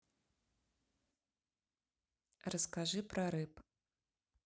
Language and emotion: Russian, neutral